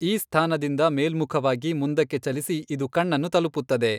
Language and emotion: Kannada, neutral